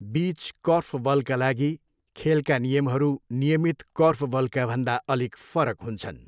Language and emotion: Nepali, neutral